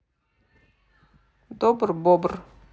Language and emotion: Russian, neutral